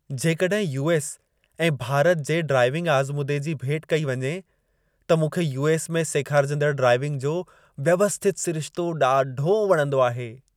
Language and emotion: Sindhi, happy